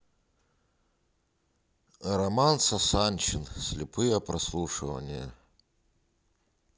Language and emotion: Russian, neutral